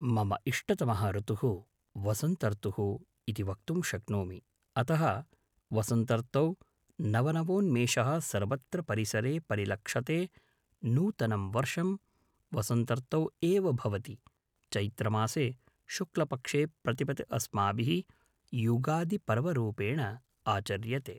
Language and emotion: Sanskrit, neutral